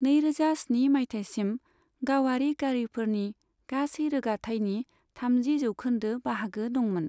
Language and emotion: Bodo, neutral